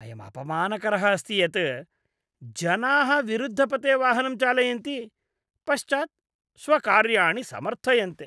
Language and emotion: Sanskrit, disgusted